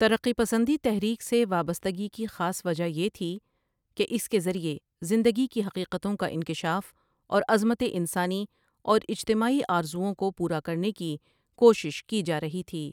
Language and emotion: Urdu, neutral